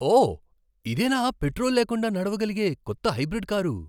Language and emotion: Telugu, surprised